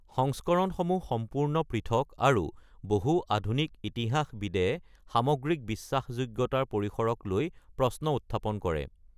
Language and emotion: Assamese, neutral